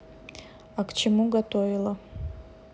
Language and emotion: Russian, neutral